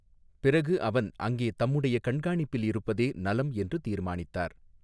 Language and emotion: Tamil, neutral